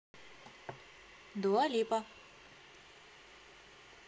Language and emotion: Russian, neutral